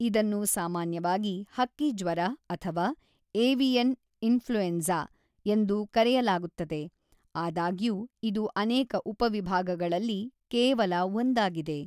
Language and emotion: Kannada, neutral